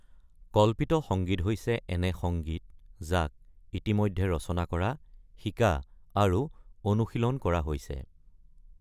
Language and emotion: Assamese, neutral